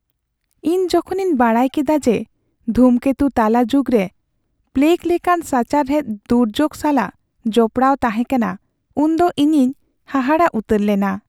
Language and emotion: Santali, sad